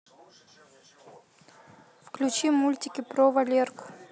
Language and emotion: Russian, neutral